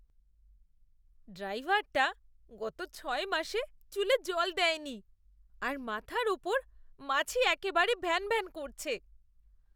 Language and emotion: Bengali, disgusted